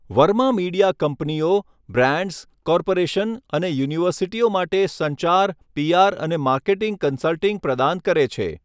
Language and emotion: Gujarati, neutral